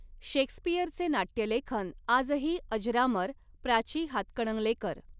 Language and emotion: Marathi, neutral